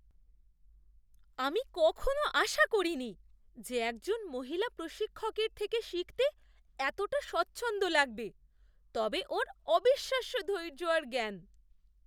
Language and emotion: Bengali, surprised